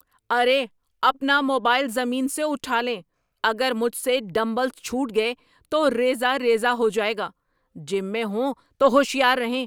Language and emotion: Urdu, angry